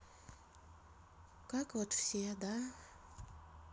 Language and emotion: Russian, neutral